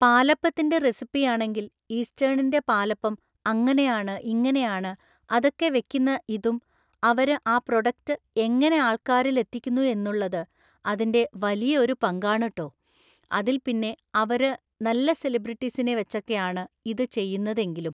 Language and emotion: Malayalam, neutral